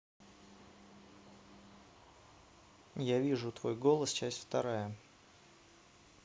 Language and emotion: Russian, neutral